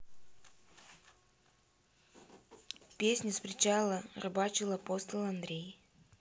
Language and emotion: Russian, neutral